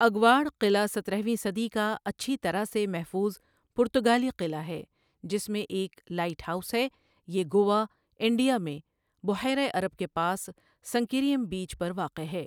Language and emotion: Urdu, neutral